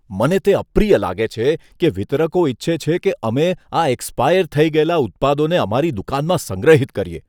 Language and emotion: Gujarati, disgusted